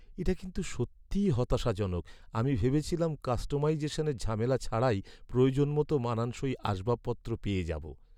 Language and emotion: Bengali, sad